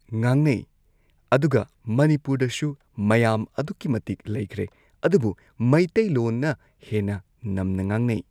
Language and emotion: Manipuri, neutral